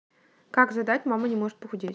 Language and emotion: Russian, neutral